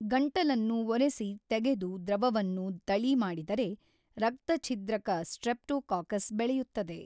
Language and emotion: Kannada, neutral